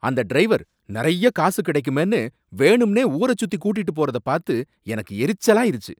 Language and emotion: Tamil, angry